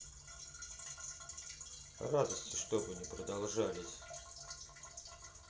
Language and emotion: Russian, neutral